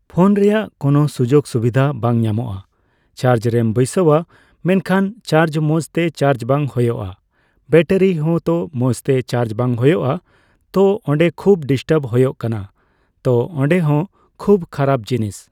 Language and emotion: Santali, neutral